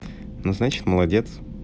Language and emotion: Russian, positive